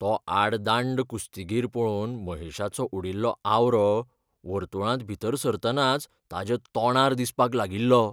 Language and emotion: Goan Konkani, fearful